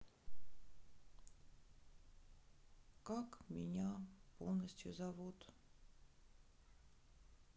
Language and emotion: Russian, sad